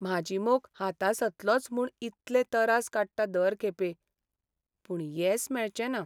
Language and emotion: Goan Konkani, sad